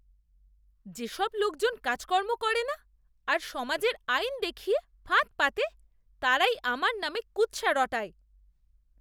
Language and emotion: Bengali, disgusted